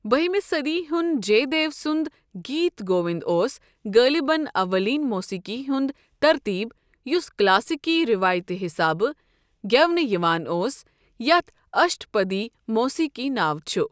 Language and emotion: Kashmiri, neutral